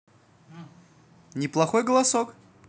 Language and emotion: Russian, positive